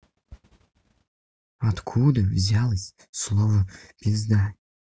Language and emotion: Russian, neutral